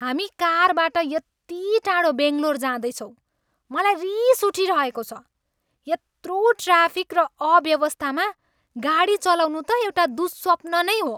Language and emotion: Nepali, angry